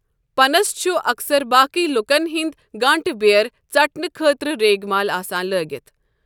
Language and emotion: Kashmiri, neutral